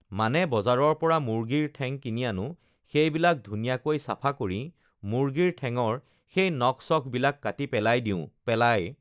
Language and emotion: Assamese, neutral